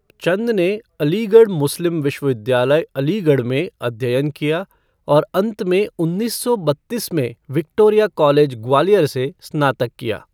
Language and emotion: Hindi, neutral